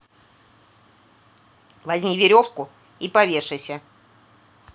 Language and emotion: Russian, angry